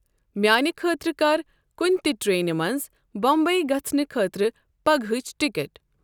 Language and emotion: Kashmiri, neutral